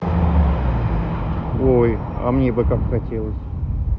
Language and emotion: Russian, neutral